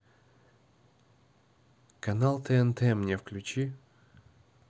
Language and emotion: Russian, neutral